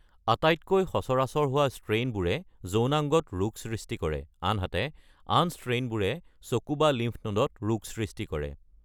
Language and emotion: Assamese, neutral